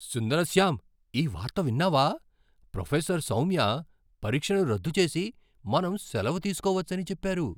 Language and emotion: Telugu, surprised